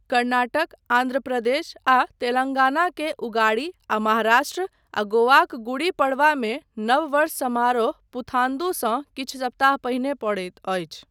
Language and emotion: Maithili, neutral